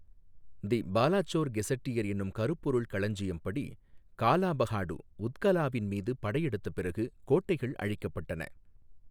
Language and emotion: Tamil, neutral